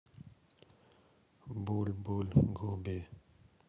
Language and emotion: Russian, sad